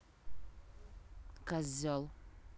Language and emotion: Russian, angry